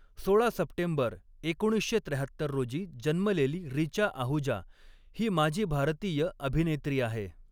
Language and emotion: Marathi, neutral